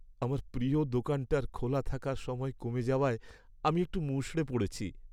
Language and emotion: Bengali, sad